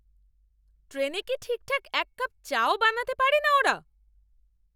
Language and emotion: Bengali, angry